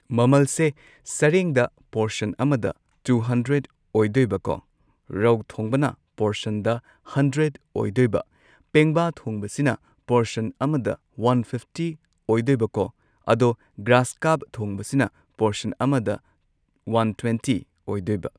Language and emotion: Manipuri, neutral